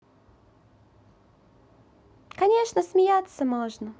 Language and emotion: Russian, positive